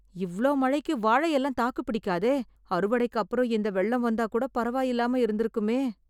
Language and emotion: Tamil, fearful